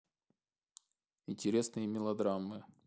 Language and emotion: Russian, neutral